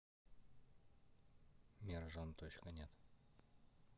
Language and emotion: Russian, neutral